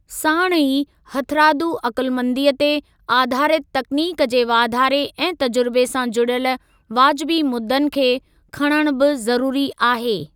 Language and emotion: Sindhi, neutral